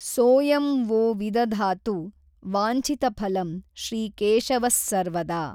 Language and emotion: Kannada, neutral